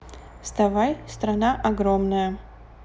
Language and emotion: Russian, neutral